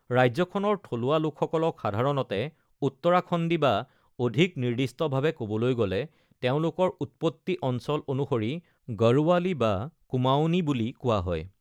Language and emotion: Assamese, neutral